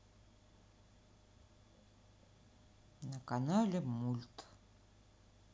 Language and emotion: Russian, sad